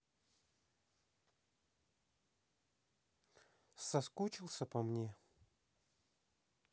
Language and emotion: Russian, neutral